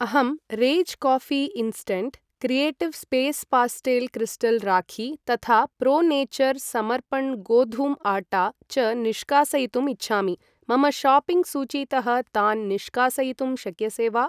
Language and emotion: Sanskrit, neutral